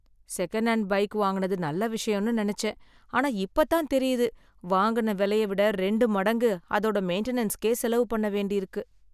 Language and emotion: Tamil, sad